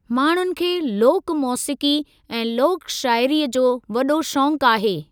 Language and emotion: Sindhi, neutral